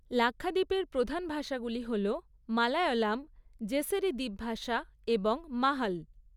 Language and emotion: Bengali, neutral